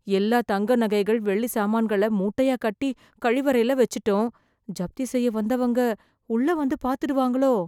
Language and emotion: Tamil, fearful